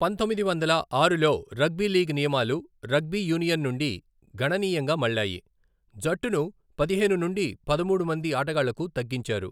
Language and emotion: Telugu, neutral